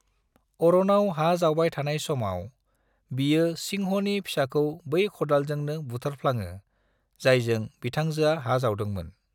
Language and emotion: Bodo, neutral